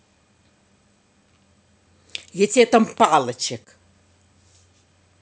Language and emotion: Russian, angry